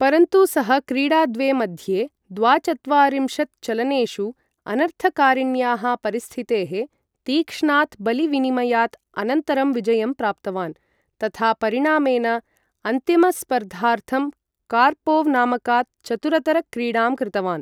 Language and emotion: Sanskrit, neutral